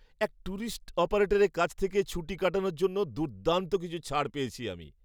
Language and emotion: Bengali, happy